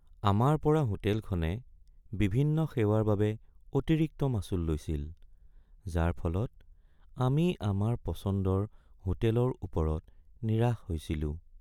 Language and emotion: Assamese, sad